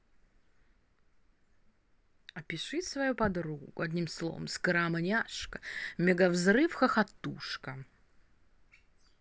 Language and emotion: Russian, positive